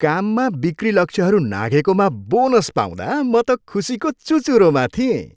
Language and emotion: Nepali, happy